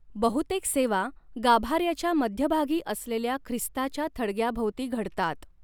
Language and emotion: Marathi, neutral